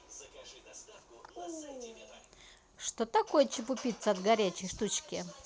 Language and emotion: Russian, neutral